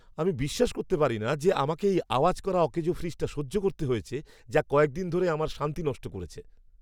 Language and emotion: Bengali, angry